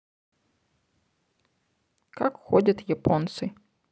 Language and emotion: Russian, neutral